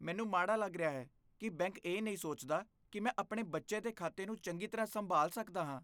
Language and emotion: Punjabi, disgusted